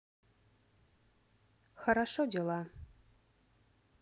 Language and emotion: Russian, neutral